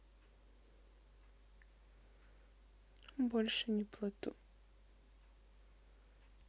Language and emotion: Russian, sad